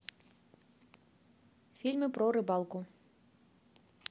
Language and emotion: Russian, neutral